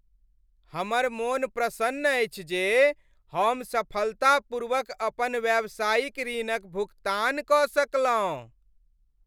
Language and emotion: Maithili, happy